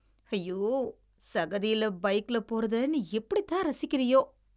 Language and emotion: Tamil, disgusted